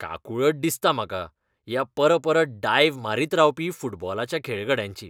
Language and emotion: Goan Konkani, disgusted